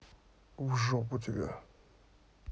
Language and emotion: Russian, angry